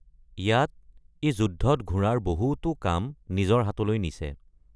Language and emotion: Assamese, neutral